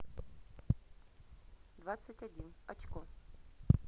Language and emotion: Russian, neutral